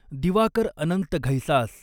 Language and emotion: Marathi, neutral